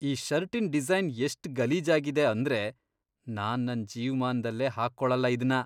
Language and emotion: Kannada, disgusted